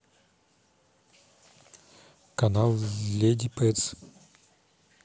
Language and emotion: Russian, neutral